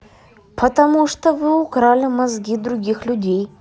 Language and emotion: Russian, neutral